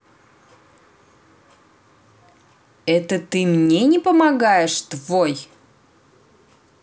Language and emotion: Russian, angry